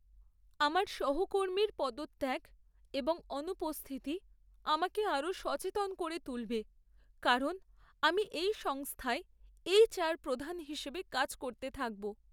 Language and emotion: Bengali, sad